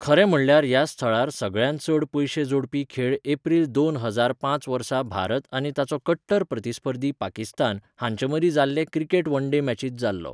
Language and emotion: Goan Konkani, neutral